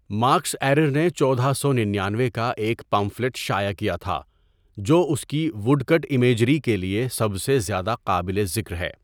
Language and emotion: Urdu, neutral